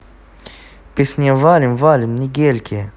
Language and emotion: Russian, neutral